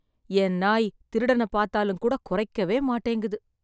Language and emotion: Tamil, sad